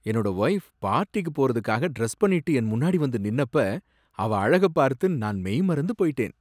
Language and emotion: Tamil, surprised